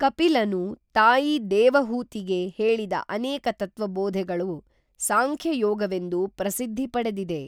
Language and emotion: Kannada, neutral